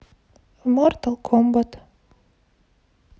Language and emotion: Russian, neutral